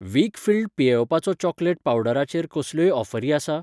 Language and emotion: Goan Konkani, neutral